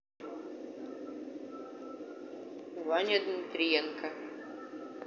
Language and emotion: Russian, neutral